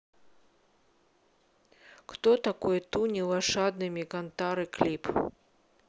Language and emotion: Russian, neutral